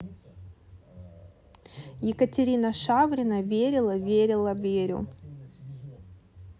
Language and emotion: Russian, neutral